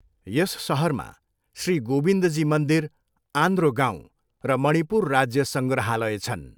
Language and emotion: Nepali, neutral